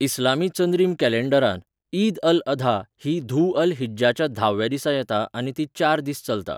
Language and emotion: Goan Konkani, neutral